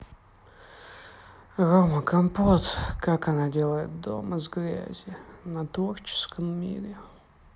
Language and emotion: Russian, sad